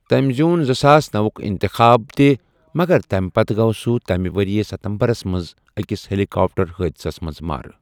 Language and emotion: Kashmiri, neutral